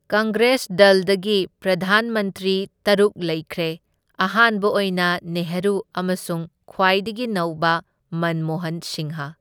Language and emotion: Manipuri, neutral